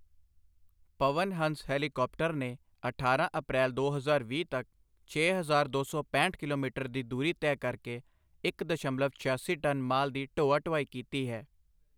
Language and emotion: Punjabi, neutral